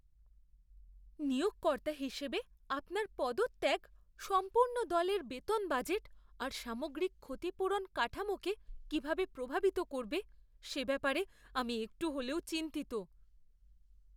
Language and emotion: Bengali, fearful